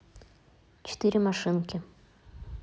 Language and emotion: Russian, neutral